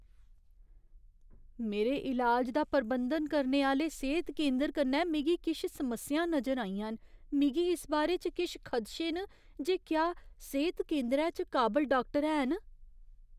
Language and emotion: Dogri, fearful